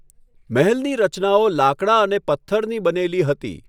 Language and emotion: Gujarati, neutral